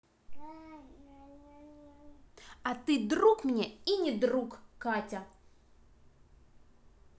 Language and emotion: Russian, neutral